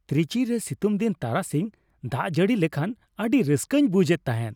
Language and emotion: Santali, happy